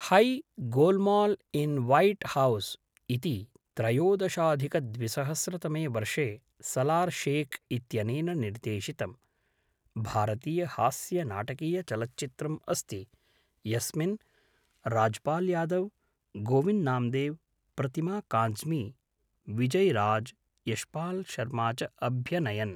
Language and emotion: Sanskrit, neutral